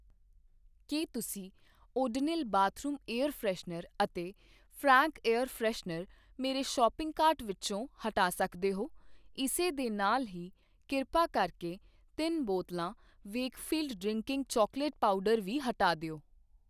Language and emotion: Punjabi, neutral